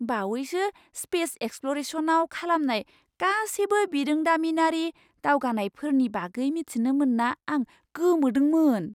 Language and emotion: Bodo, surprised